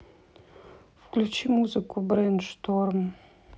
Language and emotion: Russian, neutral